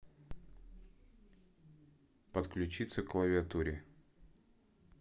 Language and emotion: Russian, neutral